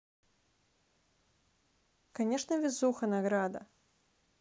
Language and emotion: Russian, neutral